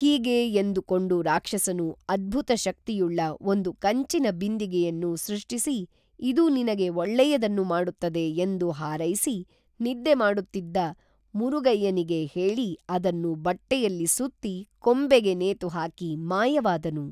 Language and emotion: Kannada, neutral